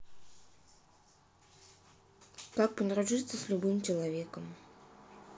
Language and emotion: Russian, neutral